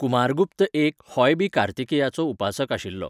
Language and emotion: Goan Konkani, neutral